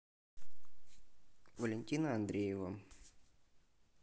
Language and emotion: Russian, neutral